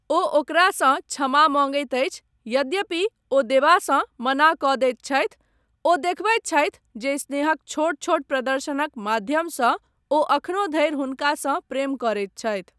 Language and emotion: Maithili, neutral